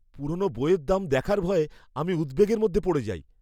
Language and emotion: Bengali, fearful